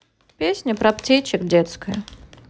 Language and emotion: Russian, neutral